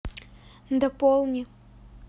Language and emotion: Russian, neutral